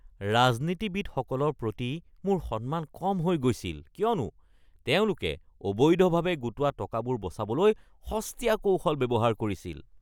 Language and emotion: Assamese, disgusted